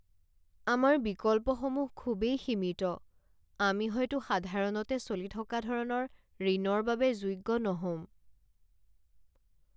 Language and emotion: Assamese, sad